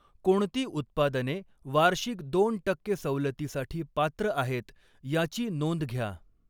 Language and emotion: Marathi, neutral